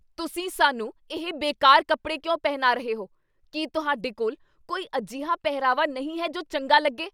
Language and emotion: Punjabi, angry